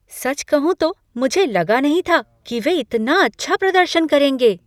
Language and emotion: Hindi, surprised